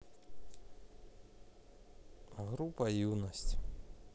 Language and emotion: Russian, neutral